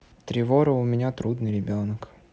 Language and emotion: Russian, neutral